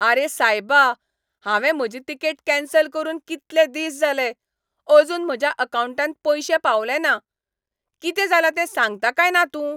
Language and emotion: Goan Konkani, angry